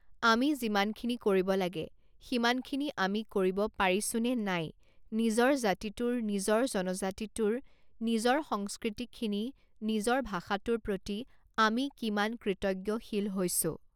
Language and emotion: Assamese, neutral